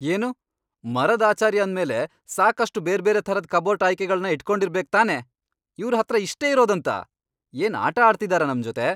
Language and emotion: Kannada, angry